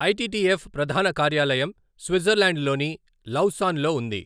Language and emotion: Telugu, neutral